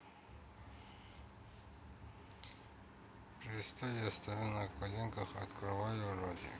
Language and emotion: Russian, neutral